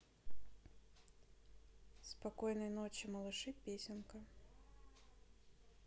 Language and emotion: Russian, neutral